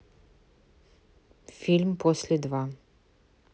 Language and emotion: Russian, neutral